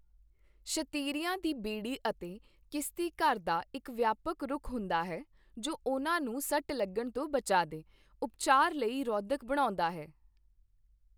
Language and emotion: Punjabi, neutral